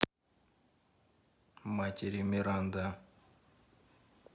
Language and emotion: Russian, neutral